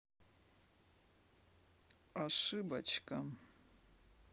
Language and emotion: Russian, neutral